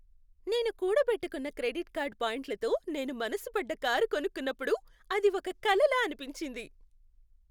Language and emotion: Telugu, happy